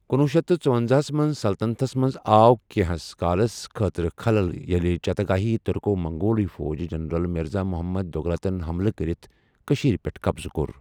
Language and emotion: Kashmiri, neutral